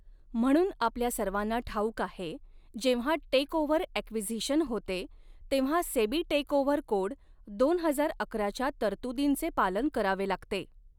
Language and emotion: Marathi, neutral